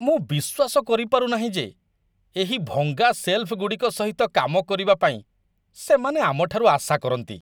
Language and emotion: Odia, disgusted